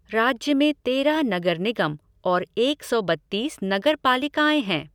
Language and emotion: Hindi, neutral